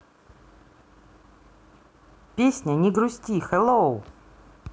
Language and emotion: Russian, positive